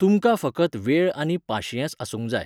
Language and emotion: Goan Konkani, neutral